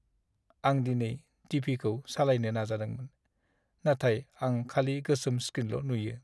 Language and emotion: Bodo, sad